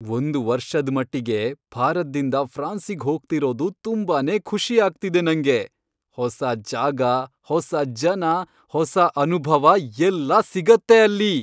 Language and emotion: Kannada, happy